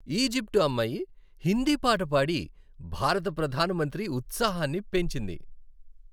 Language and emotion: Telugu, happy